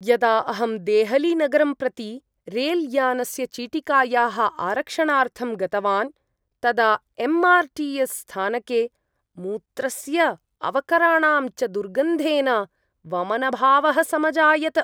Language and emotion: Sanskrit, disgusted